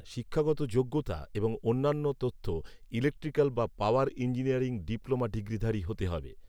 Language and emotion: Bengali, neutral